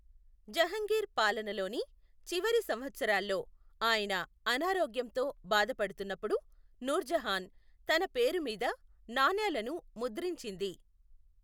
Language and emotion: Telugu, neutral